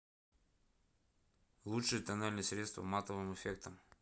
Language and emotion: Russian, neutral